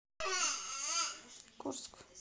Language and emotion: Russian, neutral